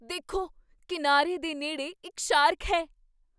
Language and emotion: Punjabi, surprised